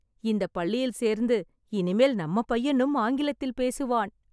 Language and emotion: Tamil, happy